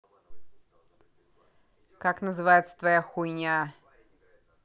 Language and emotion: Russian, angry